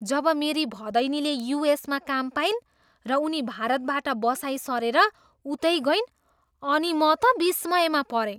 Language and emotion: Nepali, surprised